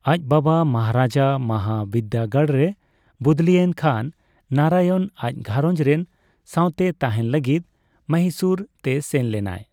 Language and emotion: Santali, neutral